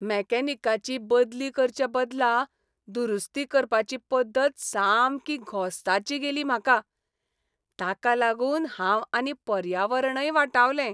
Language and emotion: Goan Konkani, happy